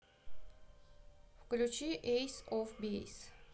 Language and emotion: Russian, neutral